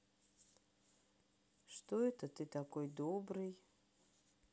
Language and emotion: Russian, sad